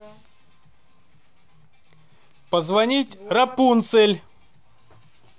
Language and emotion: Russian, positive